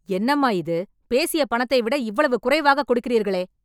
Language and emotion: Tamil, angry